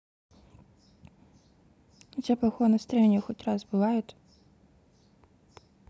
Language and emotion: Russian, neutral